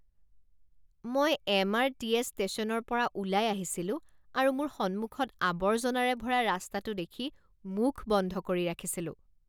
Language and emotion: Assamese, disgusted